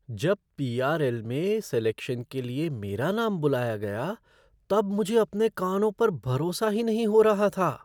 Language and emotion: Hindi, surprised